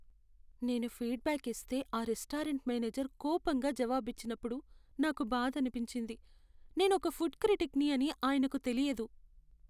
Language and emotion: Telugu, sad